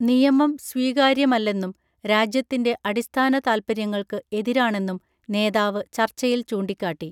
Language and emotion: Malayalam, neutral